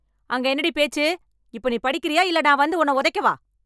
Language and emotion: Tamil, angry